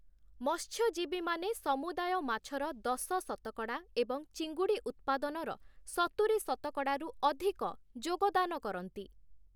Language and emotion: Odia, neutral